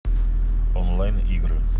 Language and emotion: Russian, neutral